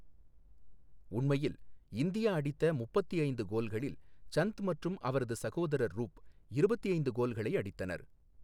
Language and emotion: Tamil, neutral